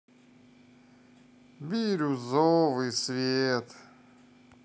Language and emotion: Russian, sad